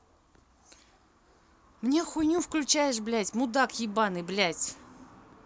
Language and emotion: Russian, angry